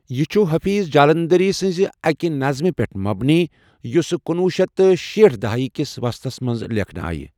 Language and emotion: Kashmiri, neutral